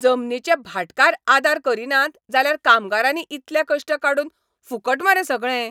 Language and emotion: Goan Konkani, angry